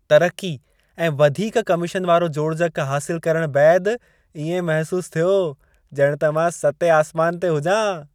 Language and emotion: Sindhi, happy